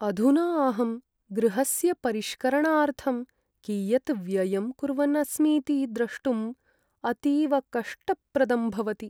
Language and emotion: Sanskrit, sad